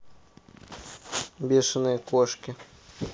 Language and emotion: Russian, neutral